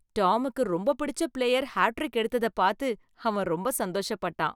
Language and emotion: Tamil, happy